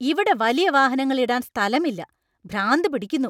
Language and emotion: Malayalam, angry